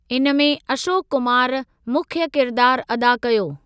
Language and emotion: Sindhi, neutral